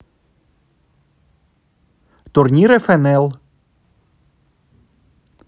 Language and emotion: Russian, neutral